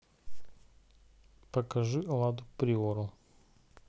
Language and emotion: Russian, neutral